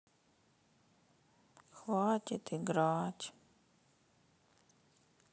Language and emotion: Russian, sad